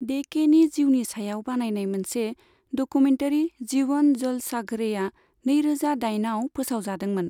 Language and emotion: Bodo, neutral